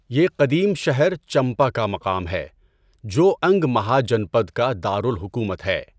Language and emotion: Urdu, neutral